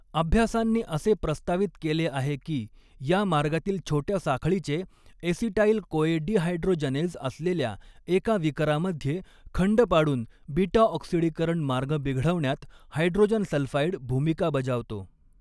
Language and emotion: Marathi, neutral